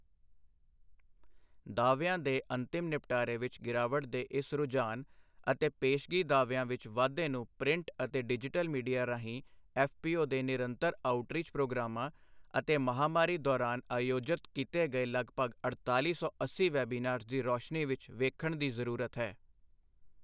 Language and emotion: Punjabi, neutral